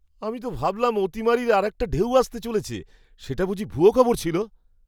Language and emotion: Bengali, surprised